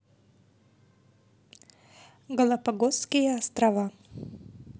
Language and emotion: Russian, neutral